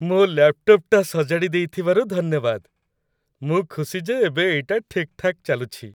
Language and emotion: Odia, happy